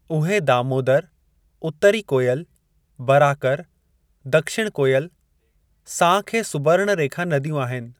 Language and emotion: Sindhi, neutral